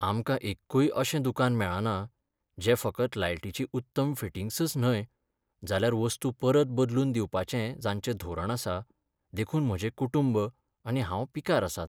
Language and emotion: Goan Konkani, sad